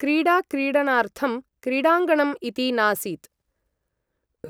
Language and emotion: Sanskrit, neutral